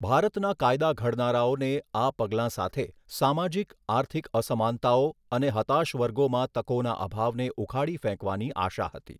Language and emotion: Gujarati, neutral